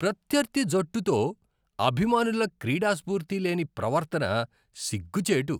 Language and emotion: Telugu, disgusted